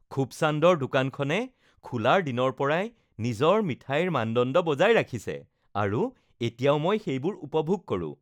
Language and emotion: Assamese, happy